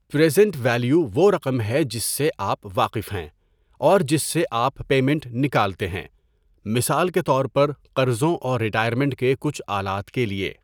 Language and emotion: Urdu, neutral